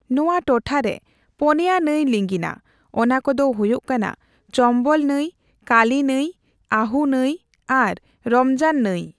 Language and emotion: Santali, neutral